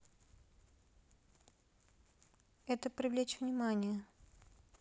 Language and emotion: Russian, neutral